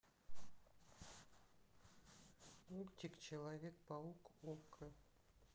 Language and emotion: Russian, neutral